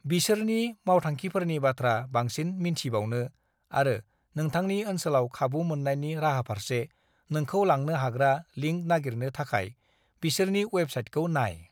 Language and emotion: Bodo, neutral